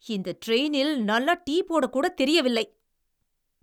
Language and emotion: Tamil, angry